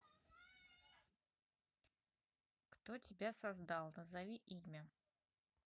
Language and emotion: Russian, neutral